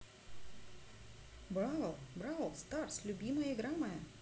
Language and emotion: Russian, neutral